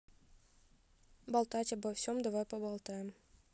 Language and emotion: Russian, neutral